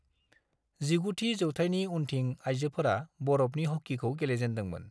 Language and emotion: Bodo, neutral